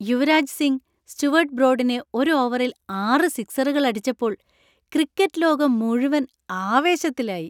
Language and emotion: Malayalam, happy